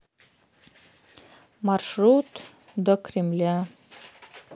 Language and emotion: Russian, neutral